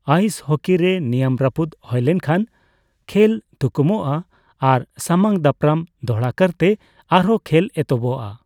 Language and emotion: Santali, neutral